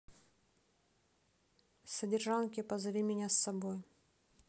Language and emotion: Russian, neutral